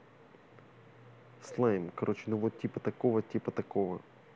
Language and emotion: Russian, neutral